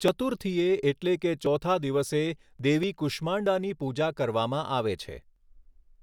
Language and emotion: Gujarati, neutral